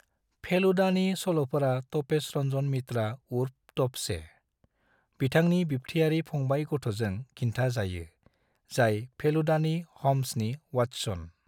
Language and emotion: Bodo, neutral